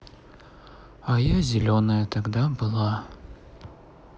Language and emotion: Russian, sad